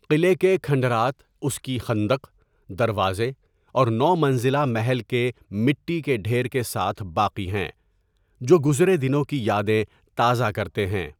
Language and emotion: Urdu, neutral